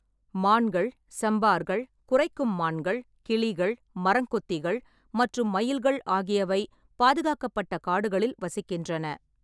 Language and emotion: Tamil, neutral